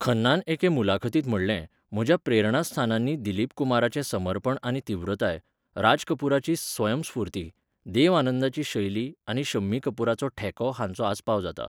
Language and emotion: Goan Konkani, neutral